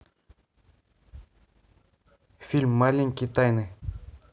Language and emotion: Russian, neutral